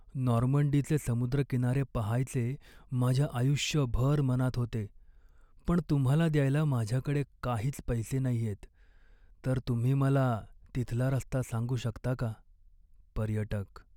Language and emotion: Marathi, sad